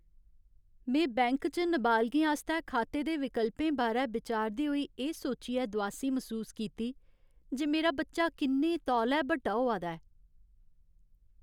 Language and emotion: Dogri, sad